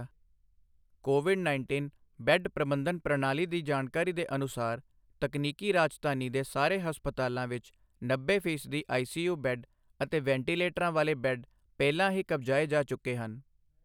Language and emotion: Punjabi, neutral